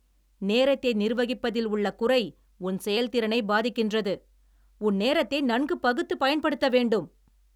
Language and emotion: Tamil, angry